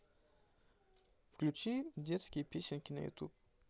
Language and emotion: Russian, neutral